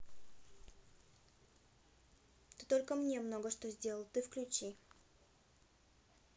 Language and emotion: Russian, neutral